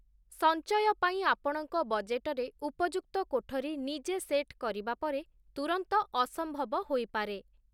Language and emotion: Odia, neutral